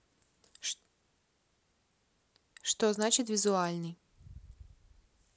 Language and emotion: Russian, neutral